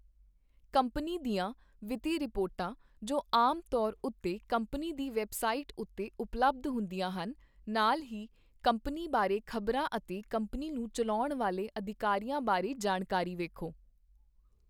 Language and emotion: Punjabi, neutral